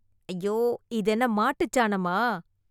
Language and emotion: Tamil, disgusted